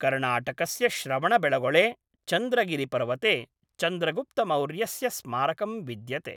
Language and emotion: Sanskrit, neutral